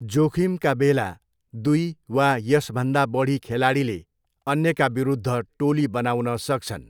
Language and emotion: Nepali, neutral